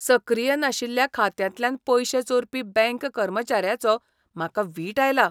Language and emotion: Goan Konkani, disgusted